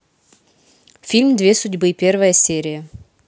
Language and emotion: Russian, neutral